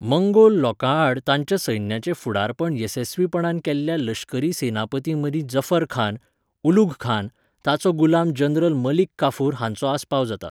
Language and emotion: Goan Konkani, neutral